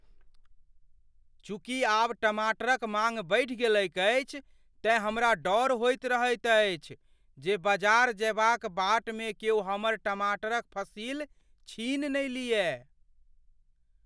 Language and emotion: Maithili, fearful